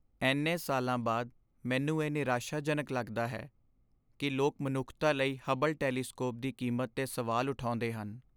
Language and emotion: Punjabi, sad